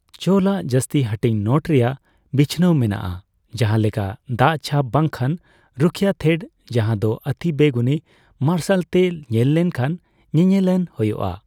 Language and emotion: Santali, neutral